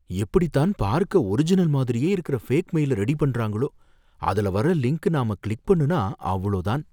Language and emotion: Tamil, fearful